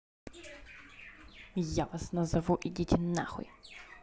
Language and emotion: Russian, angry